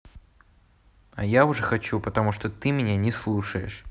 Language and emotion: Russian, neutral